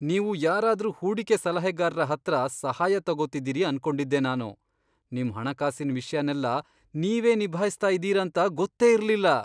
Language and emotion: Kannada, surprised